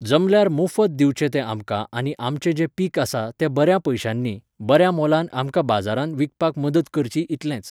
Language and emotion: Goan Konkani, neutral